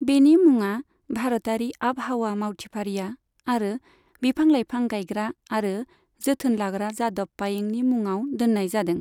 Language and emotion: Bodo, neutral